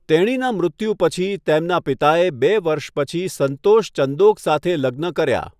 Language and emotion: Gujarati, neutral